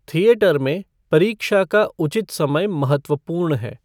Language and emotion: Hindi, neutral